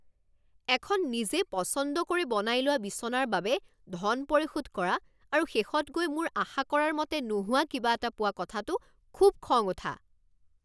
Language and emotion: Assamese, angry